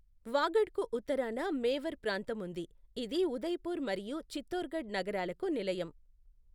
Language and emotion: Telugu, neutral